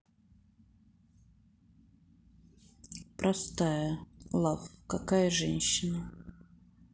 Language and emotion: Russian, sad